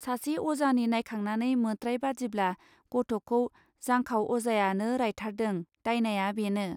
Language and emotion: Bodo, neutral